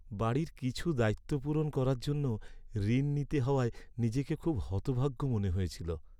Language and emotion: Bengali, sad